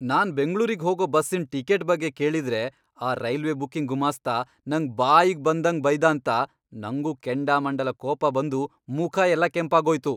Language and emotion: Kannada, angry